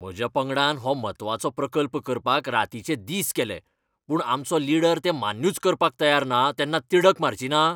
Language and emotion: Goan Konkani, angry